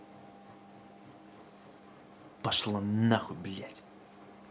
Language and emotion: Russian, angry